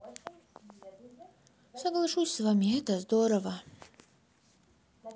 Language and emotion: Russian, sad